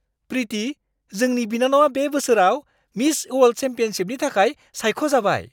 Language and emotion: Bodo, surprised